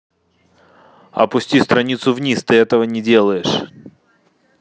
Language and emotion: Russian, angry